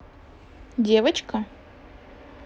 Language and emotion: Russian, neutral